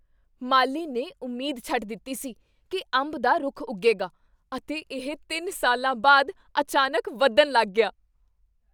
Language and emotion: Punjabi, surprised